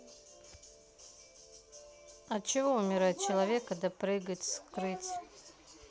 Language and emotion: Russian, neutral